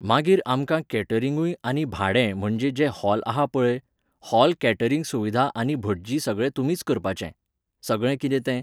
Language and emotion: Goan Konkani, neutral